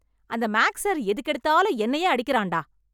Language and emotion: Tamil, angry